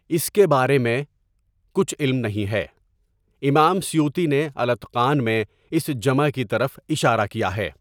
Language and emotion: Urdu, neutral